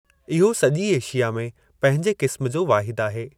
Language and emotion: Sindhi, neutral